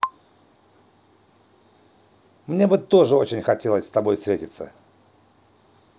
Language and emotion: Russian, positive